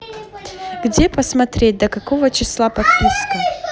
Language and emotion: Russian, neutral